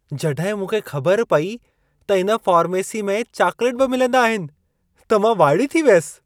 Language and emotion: Sindhi, surprised